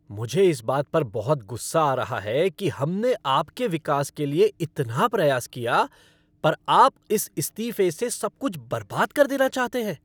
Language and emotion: Hindi, angry